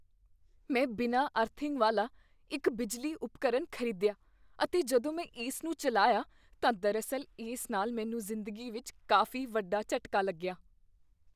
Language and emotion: Punjabi, fearful